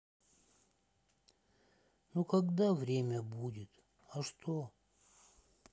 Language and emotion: Russian, sad